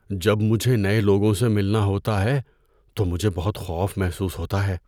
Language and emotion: Urdu, fearful